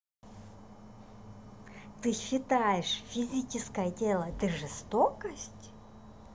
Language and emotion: Russian, neutral